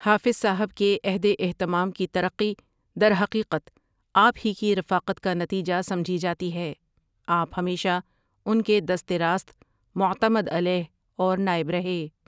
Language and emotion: Urdu, neutral